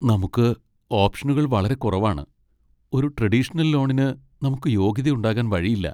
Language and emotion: Malayalam, sad